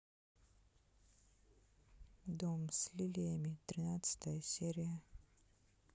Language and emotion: Russian, neutral